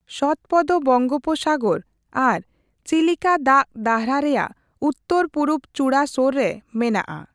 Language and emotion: Santali, neutral